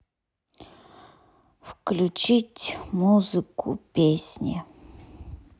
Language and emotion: Russian, neutral